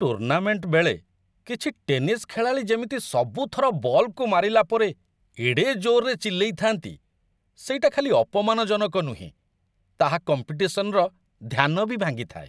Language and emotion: Odia, disgusted